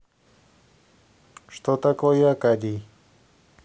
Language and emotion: Russian, neutral